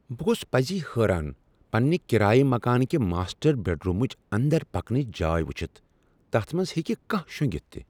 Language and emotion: Kashmiri, surprised